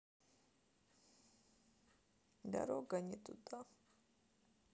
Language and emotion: Russian, sad